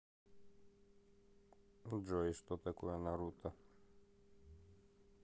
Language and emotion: Russian, neutral